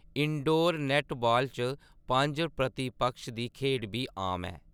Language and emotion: Dogri, neutral